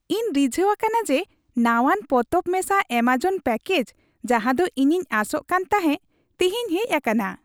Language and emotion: Santali, happy